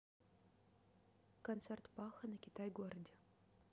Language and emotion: Russian, neutral